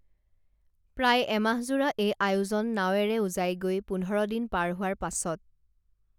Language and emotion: Assamese, neutral